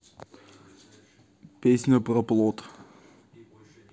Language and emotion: Russian, neutral